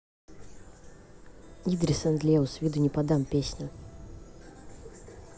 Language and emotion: Russian, neutral